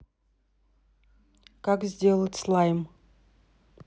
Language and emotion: Russian, neutral